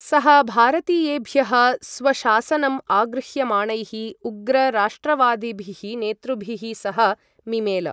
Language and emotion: Sanskrit, neutral